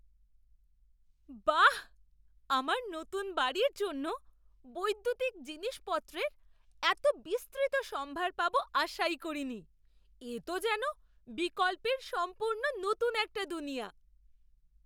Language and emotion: Bengali, surprised